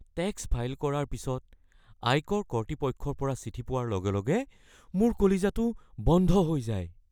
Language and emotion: Assamese, fearful